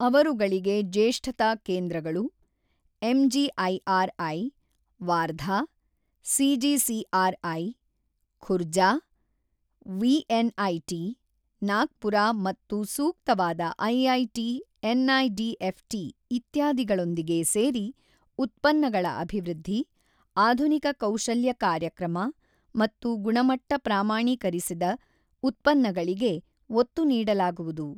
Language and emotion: Kannada, neutral